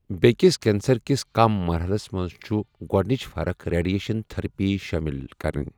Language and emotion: Kashmiri, neutral